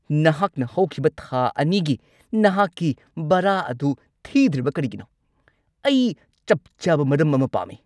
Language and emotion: Manipuri, angry